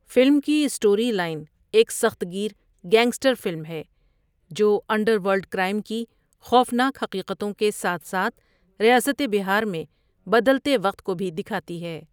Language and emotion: Urdu, neutral